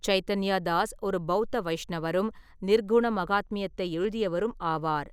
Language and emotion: Tamil, neutral